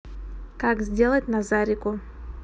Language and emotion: Russian, neutral